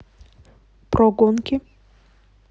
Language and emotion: Russian, neutral